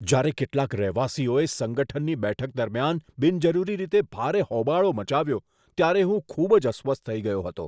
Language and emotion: Gujarati, disgusted